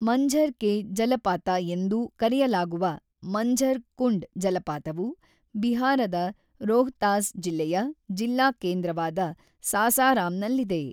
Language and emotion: Kannada, neutral